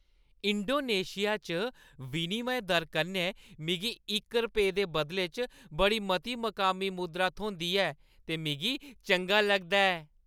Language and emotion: Dogri, happy